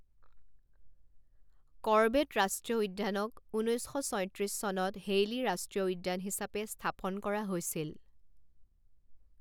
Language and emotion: Assamese, neutral